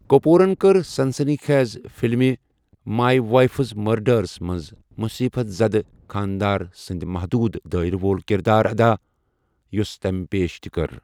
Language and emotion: Kashmiri, neutral